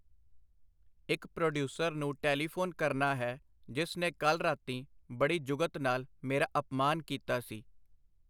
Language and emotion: Punjabi, neutral